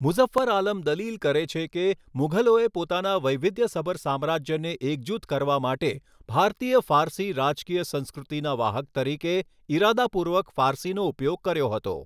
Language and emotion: Gujarati, neutral